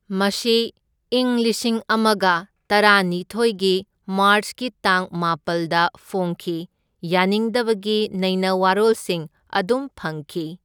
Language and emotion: Manipuri, neutral